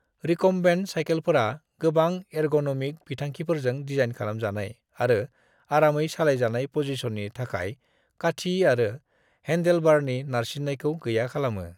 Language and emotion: Bodo, neutral